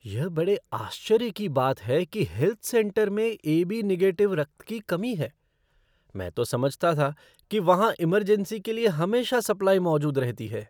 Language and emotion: Hindi, surprised